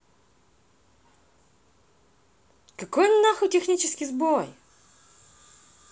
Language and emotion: Russian, angry